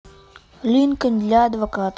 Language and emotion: Russian, neutral